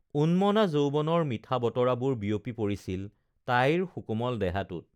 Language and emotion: Assamese, neutral